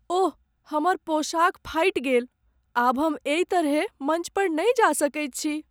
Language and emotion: Maithili, sad